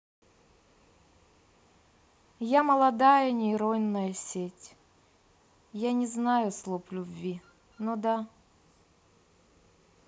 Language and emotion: Russian, neutral